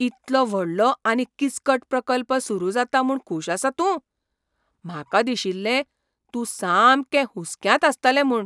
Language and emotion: Goan Konkani, surprised